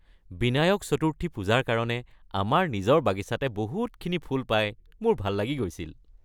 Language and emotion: Assamese, happy